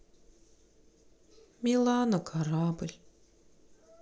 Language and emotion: Russian, sad